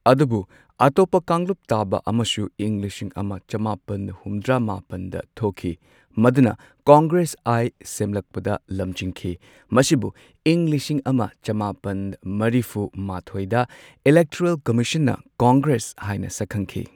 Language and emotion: Manipuri, neutral